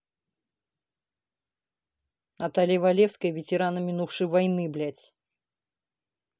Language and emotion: Russian, angry